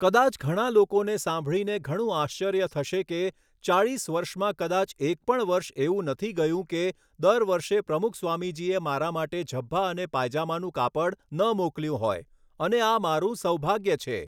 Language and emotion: Gujarati, neutral